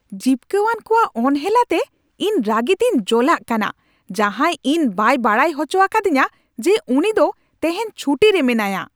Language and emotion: Santali, angry